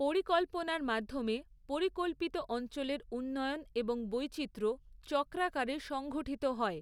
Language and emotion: Bengali, neutral